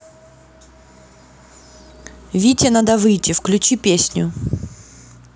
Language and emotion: Russian, neutral